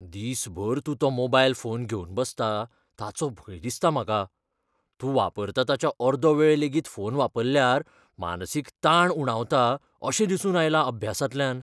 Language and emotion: Goan Konkani, fearful